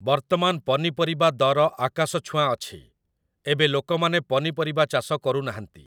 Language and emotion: Odia, neutral